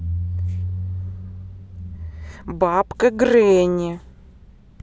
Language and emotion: Russian, angry